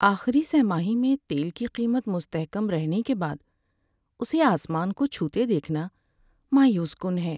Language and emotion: Urdu, sad